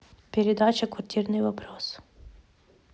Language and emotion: Russian, neutral